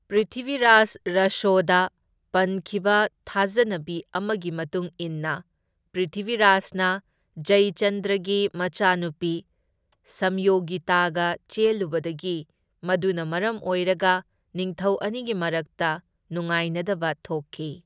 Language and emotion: Manipuri, neutral